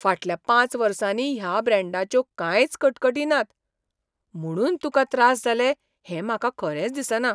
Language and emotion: Goan Konkani, surprised